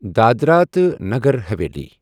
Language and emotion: Kashmiri, neutral